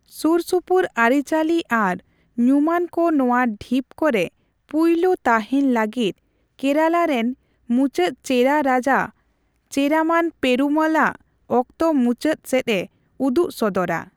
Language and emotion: Santali, neutral